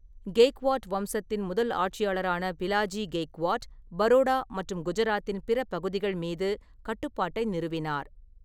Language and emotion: Tamil, neutral